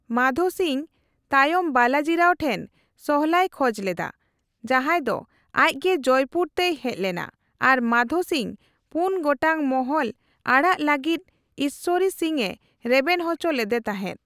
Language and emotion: Santali, neutral